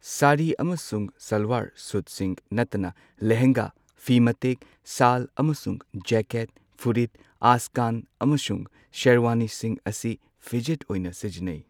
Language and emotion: Manipuri, neutral